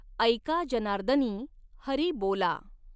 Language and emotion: Marathi, neutral